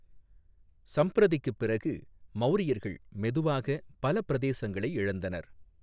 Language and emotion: Tamil, neutral